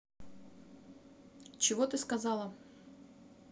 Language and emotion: Russian, neutral